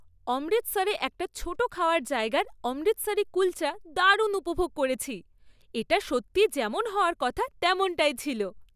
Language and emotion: Bengali, happy